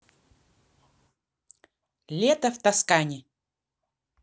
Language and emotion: Russian, neutral